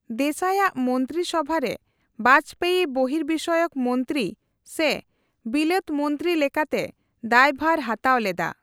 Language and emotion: Santali, neutral